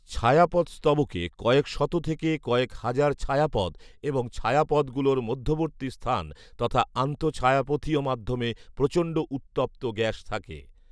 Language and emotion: Bengali, neutral